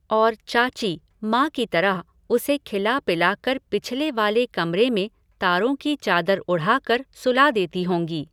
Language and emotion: Hindi, neutral